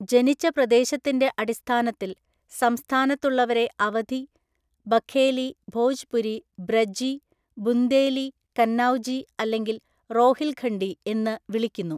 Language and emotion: Malayalam, neutral